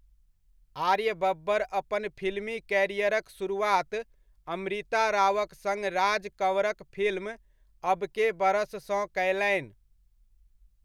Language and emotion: Maithili, neutral